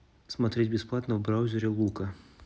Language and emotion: Russian, neutral